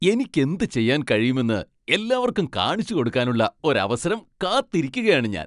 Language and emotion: Malayalam, happy